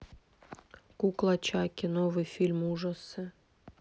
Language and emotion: Russian, neutral